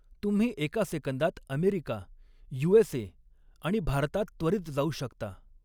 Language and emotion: Marathi, neutral